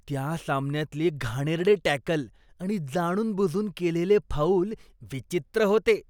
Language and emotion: Marathi, disgusted